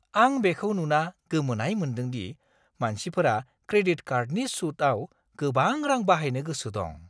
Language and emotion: Bodo, surprised